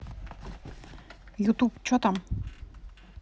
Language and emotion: Russian, neutral